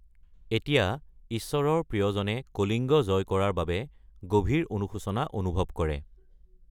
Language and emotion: Assamese, neutral